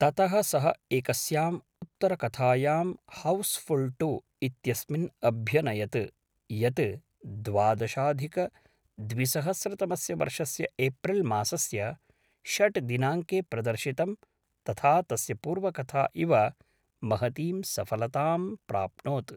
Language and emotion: Sanskrit, neutral